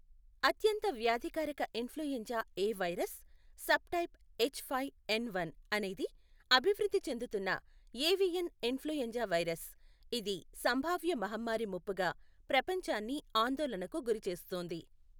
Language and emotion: Telugu, neutral